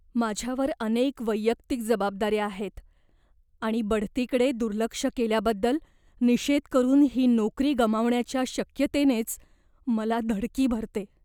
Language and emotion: Marathi, fearful